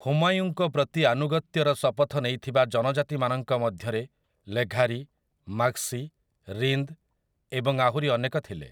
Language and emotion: Odia, neutral